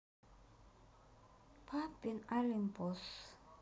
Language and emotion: Russian, sad